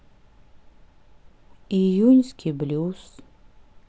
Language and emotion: Russian, sad